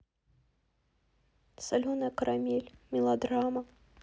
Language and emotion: Russian, sad